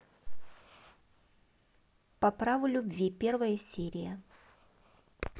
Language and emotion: Russian, neutral